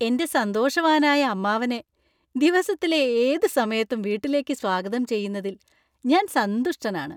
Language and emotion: Malayalam, happy